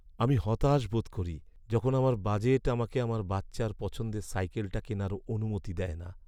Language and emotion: Bengali, sad